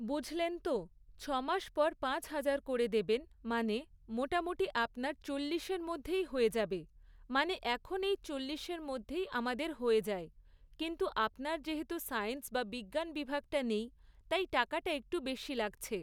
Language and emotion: Bengali, neutral